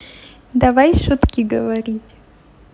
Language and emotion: Russian, positive